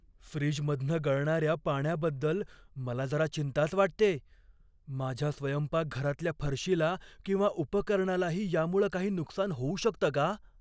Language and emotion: Marathi, fearful